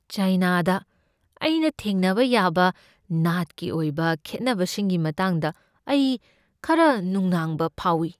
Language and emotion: Manipuri, fearful